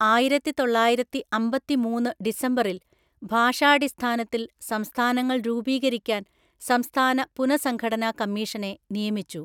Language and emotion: Malayalam, neutral